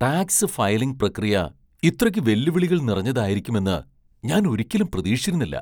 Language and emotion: Malayalam, surprised